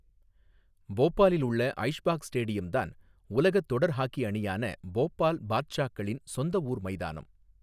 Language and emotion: Tamil, neutral